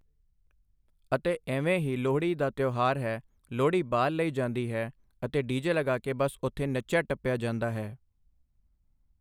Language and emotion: Punjabi, neutral